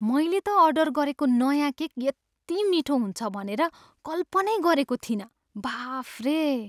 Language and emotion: Nepali, surprised